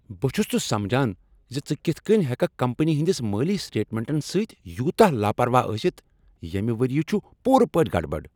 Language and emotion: Kashmiri, angry